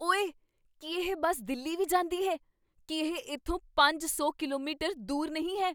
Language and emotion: Punjabi, surprised